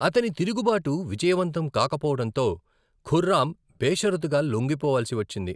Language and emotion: Telugu, neutral